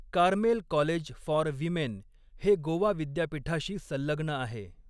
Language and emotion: Marathi, neutral